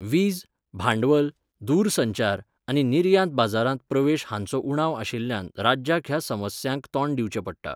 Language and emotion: Goan Konkani, neutral